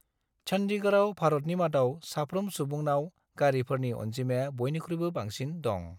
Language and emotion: Bodo, neutral